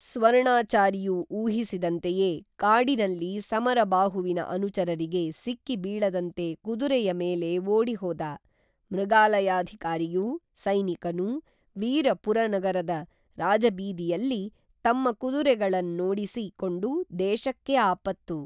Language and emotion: Kannada, neutral